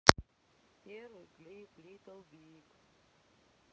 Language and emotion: Russian, neutral